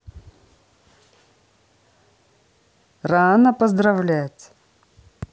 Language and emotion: Russian, neutral